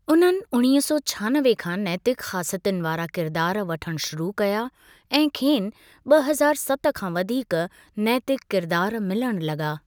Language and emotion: Sindhi, neutral